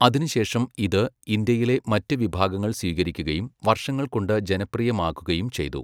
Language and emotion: Malayalam, neutral